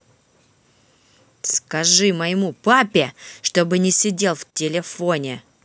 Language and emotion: Russian, angry